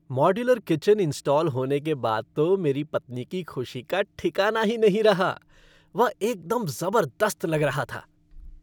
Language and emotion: Hindi, happy